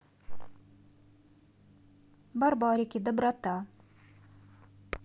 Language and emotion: Russian, neutral